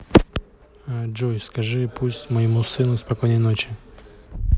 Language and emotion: Russian, neutral